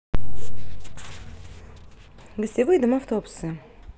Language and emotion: Russian, neutral